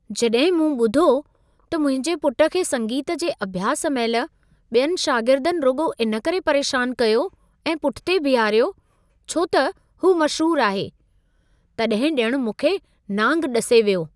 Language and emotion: Sindhi, surprised